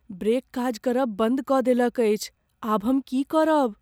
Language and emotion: Maithili, fearful